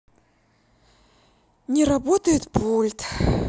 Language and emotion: Russian, sad